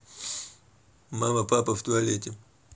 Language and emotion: Russian, neutral